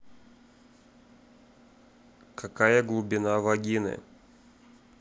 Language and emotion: Russian, neutral